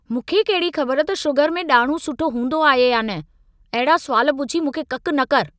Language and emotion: Sindhi, angry